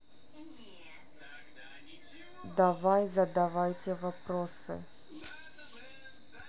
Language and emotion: Russian, neutral